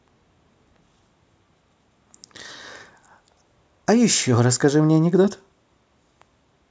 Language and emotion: Russian, positive